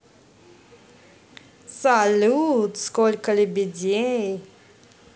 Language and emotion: Russian, positive